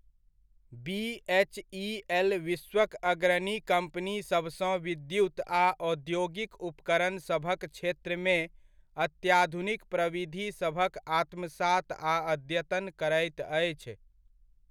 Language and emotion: Maithili, neutral